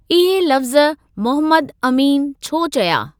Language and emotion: Sindhi, neutral